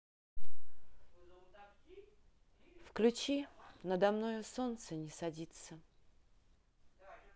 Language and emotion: Russian, neutral